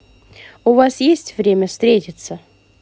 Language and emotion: Russian, neutral